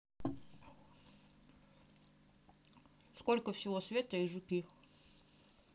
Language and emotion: Russian, neutral